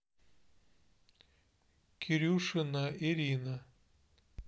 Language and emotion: Russian, neutral